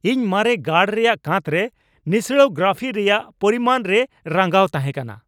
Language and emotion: Santali, angry